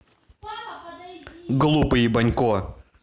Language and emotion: Russian, angry